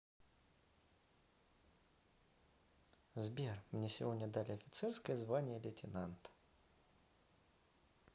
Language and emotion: Russian, positive